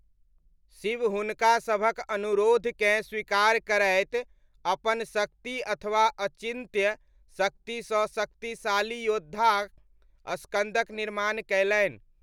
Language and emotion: Maithili, neutral